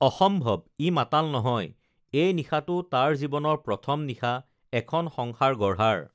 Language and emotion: Assamese, neutral